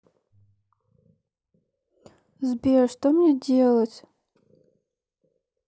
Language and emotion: Russian, sad